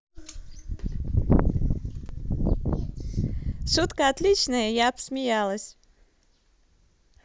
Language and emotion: Russian, positive